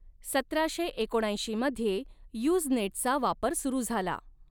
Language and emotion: Marathi, neutral